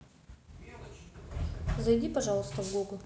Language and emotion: Russian, neutral